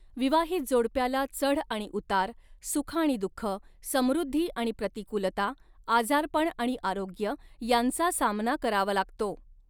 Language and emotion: Marathi, neutral